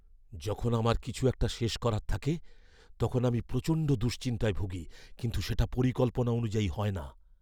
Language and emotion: Bengali, fearful